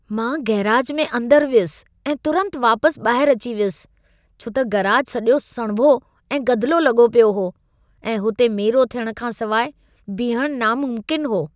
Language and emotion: Sindhi, disgusted